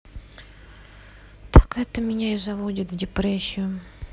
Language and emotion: Russian, sad